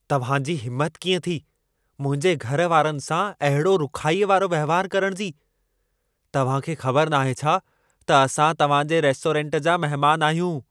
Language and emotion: Sindhi, angry